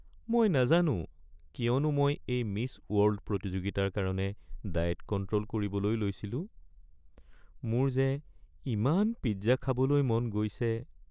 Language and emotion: Assamese, sad